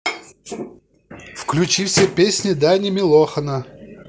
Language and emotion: Russian, positive